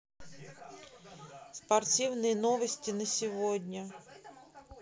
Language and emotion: Russian, neutral